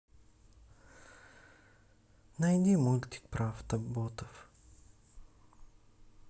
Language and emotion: Russian, sad